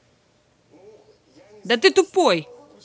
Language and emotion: Russian, angry